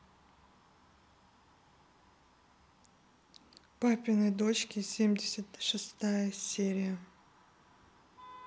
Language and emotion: Russian, neutral